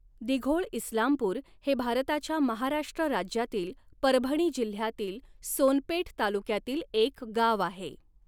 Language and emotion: Marathi, neutral